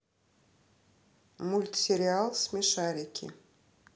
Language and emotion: Russian, neutral